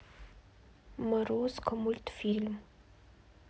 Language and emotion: Russian, neutral